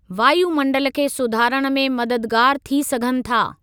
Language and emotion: Sindhi, neutral